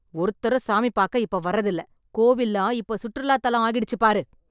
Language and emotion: Tamil, angry